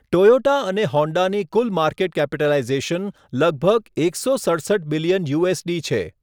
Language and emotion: Gujarati, neutral